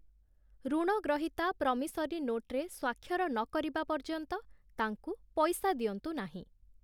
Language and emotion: Odia, neutral